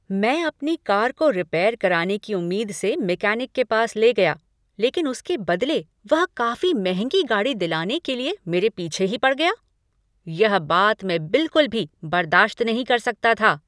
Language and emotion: Hindi, angry